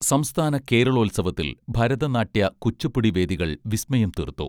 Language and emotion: Malayalam, neutral